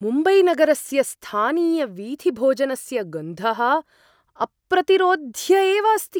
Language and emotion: Sanskrit, surprised